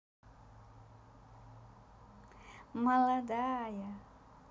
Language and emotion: Russian, positive